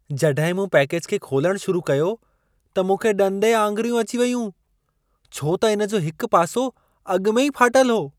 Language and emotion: Sindhi, surprised